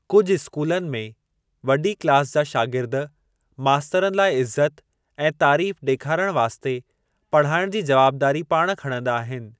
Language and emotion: Sindhi, neutral